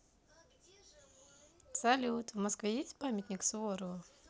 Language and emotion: Russian, positive